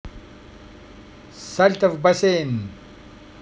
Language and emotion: Russian, positive